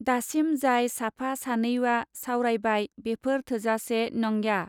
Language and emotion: Bodo, neutral